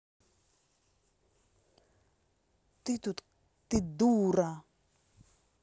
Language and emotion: Russian, angry